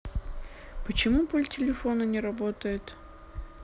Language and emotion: Russian, neutral